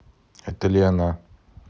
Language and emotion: Russian, neutral